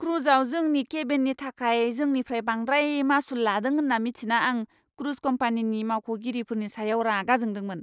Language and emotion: Bodo, angry